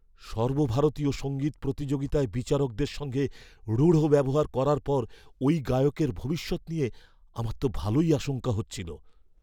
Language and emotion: Bengali, fearful